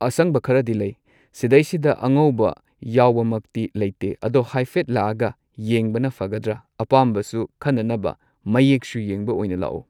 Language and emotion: Manipuri, neutral